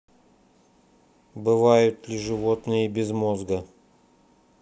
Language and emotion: Russian, neutral